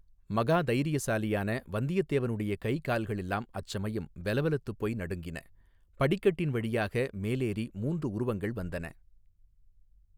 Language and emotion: Tamil, neutral